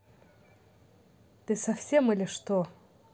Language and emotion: Russian, angry